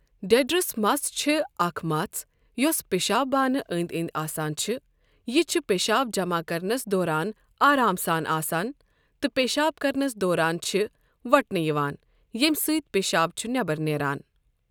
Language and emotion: Kashmiri, neutral